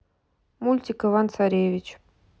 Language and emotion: Russian, neutral